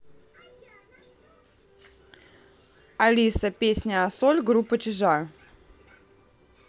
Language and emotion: Russian, neutral